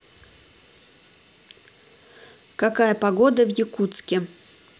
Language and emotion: Russian, neutral